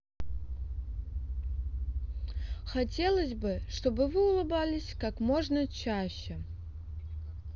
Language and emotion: Russian, neutral